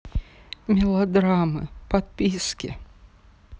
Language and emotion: Russian, angry